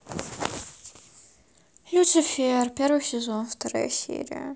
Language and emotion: Russian, sad